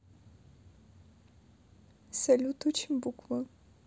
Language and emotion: Russian, sad